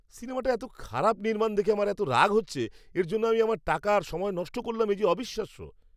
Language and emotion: Bengali, angry